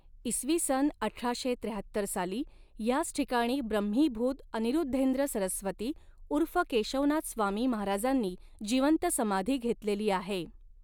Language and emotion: Marathi, neutral